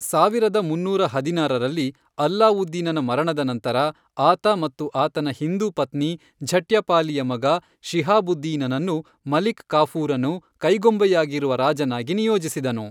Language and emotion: Kannada, neutral